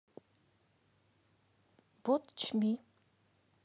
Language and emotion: Russian, neutral